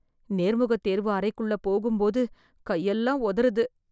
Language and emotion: Tamil, fearful